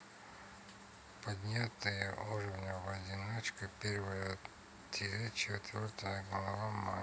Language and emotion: Russian, neutral